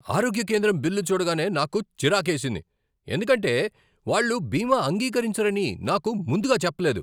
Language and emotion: Telugu, angry